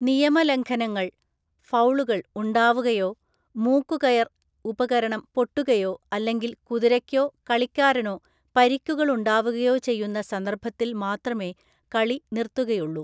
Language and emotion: Malayalam, neutral